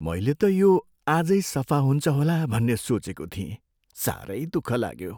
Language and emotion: Nepali, sad